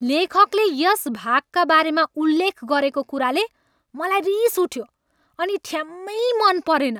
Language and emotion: Nepali, angry